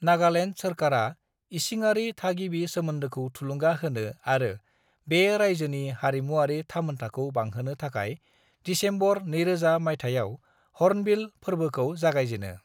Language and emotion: Bodo, neutral